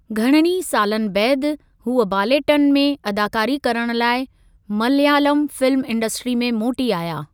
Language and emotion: Sindhi, neutral